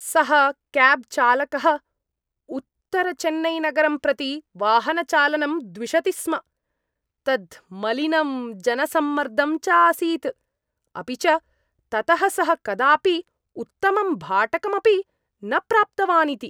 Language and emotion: Sanskrit, disgusted